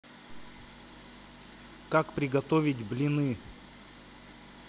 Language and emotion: Russian, neutral